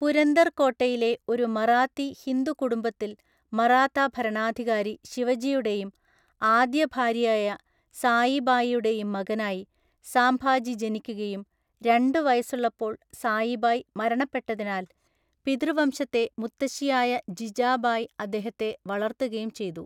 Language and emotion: Malayalam, neutral